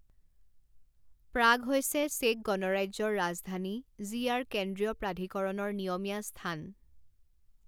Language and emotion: Assamese, neutral